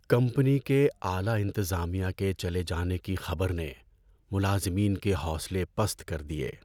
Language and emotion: Urdu, sad